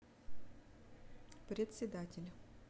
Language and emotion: Russian, neutral